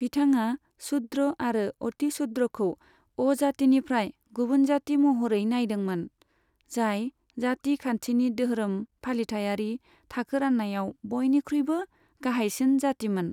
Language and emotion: Bodo, neutral